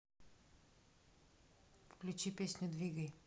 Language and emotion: Russian, neutral